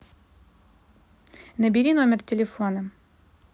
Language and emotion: Russian, neutral